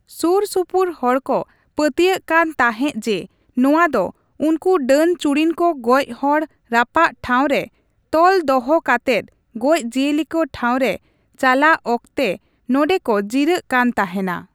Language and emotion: Santali, neutral